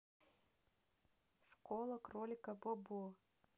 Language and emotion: Russian, neutral